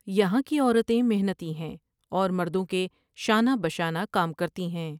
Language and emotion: Urdu, neutral